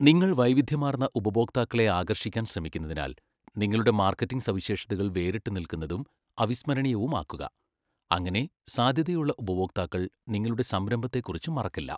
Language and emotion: Malayalam, neutral